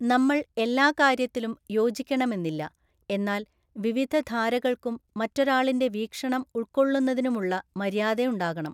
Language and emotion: Malayalam, neutral